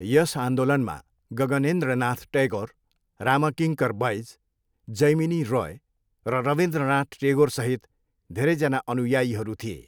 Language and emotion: Nepali, neutral